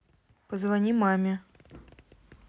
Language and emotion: Russian, neutral